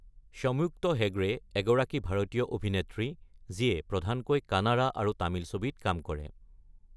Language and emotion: Assamese, neutral